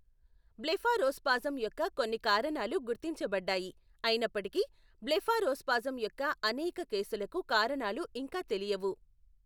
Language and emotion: Telugu, neutral